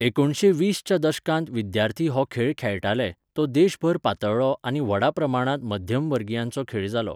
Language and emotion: Goan Konkani, neutral